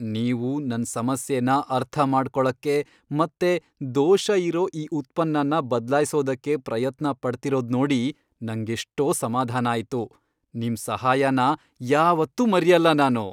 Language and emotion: Kannada, happy